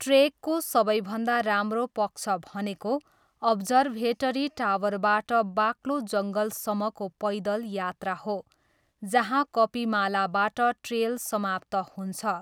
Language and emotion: Nepali, neutral